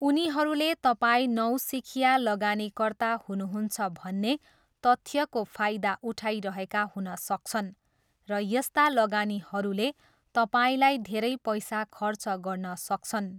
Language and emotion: Nepali, neutral